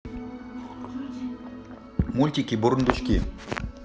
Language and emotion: Russian, neutral